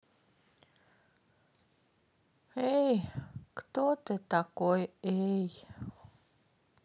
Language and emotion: Russian, sad